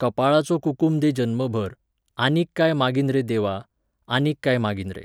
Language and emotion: Goan Konkani, neutral